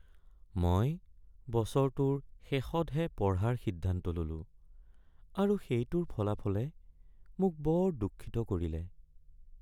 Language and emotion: Assamese, sad